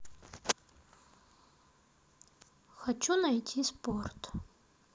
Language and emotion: Russian, neutral